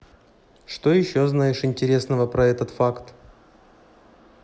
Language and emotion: Russian, neutral